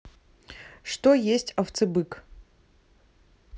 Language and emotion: Russian, neutral